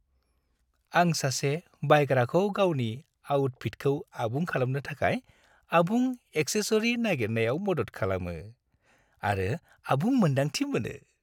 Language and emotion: Bodo, happy